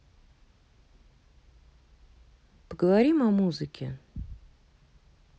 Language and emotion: Russian, neutral